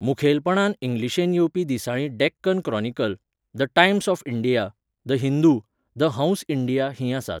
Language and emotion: Goan Konkani, neutral